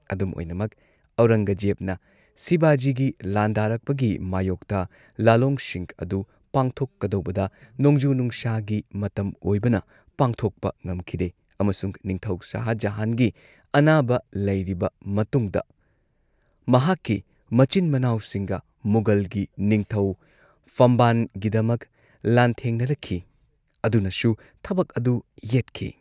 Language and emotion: Manipuri, neutral